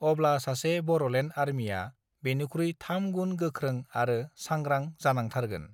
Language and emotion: Bodo, neutral